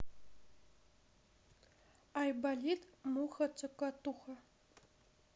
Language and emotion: Russian, neutral